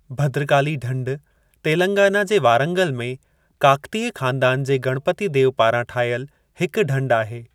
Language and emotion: Sindhi, neutral